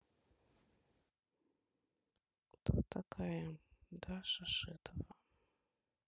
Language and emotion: Russian, sad